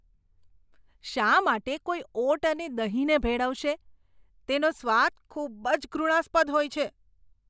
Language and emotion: Gujarati, disgusted